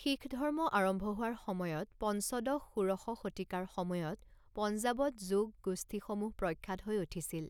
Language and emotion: Assamese, neutral